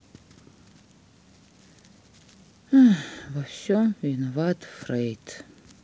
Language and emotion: Russian, sad